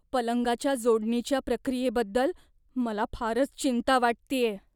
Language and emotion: Marathi, fearful